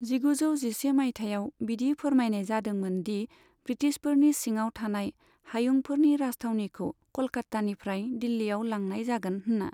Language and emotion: Bodo, neutral